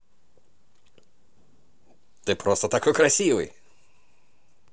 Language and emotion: Russian, positive